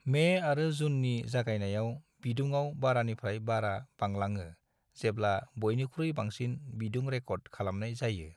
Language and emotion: Bodo, neutral